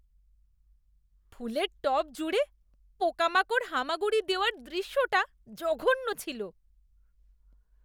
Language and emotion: Bengali, disgusted